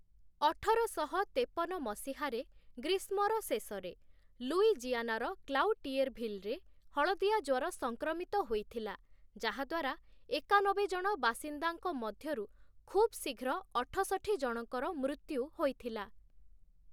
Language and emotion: Odia, neutral